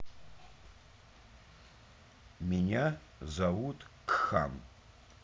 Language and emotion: Russian, neutral